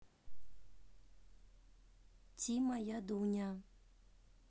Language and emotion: Russian, neutral